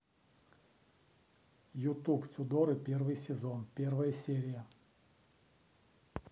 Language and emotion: Russian, neutral